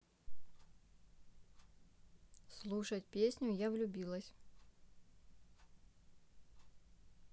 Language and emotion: Russian, neutral